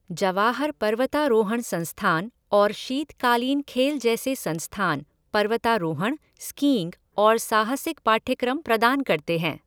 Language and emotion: Hindi, neutral